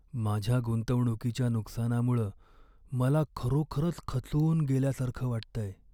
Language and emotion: Marathi, sad